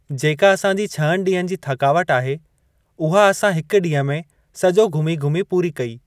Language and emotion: Sindhi, neutral